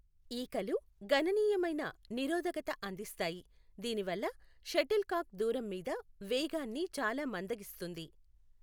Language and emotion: Telugu, neutral